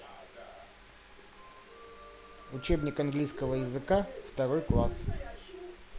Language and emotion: Russian, neutral